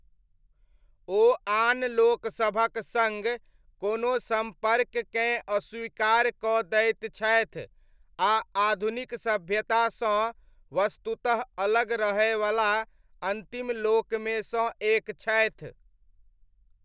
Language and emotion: Maithili, neutral